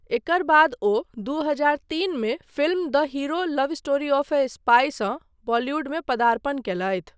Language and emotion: Maithili, neutral